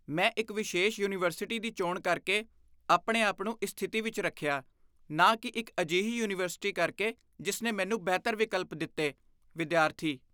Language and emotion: Punjabi, disgusted